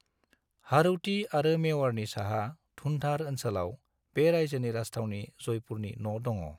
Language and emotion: Bodo, neutral